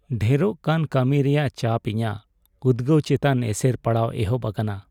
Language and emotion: Santali, sad